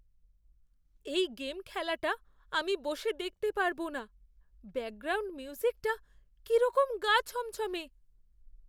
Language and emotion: Bengali, fearful